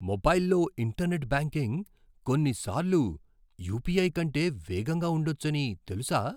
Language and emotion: Telugu, surprised